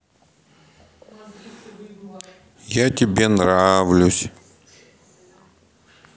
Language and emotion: Russian, sad